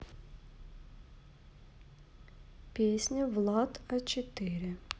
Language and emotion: Russian, neutral